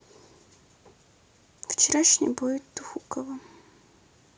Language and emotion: Russian, sad